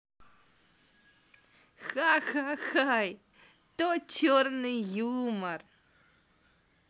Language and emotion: Russian, positive